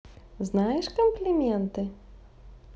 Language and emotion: Russian, positive